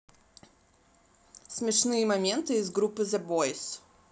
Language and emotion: Russian, neutral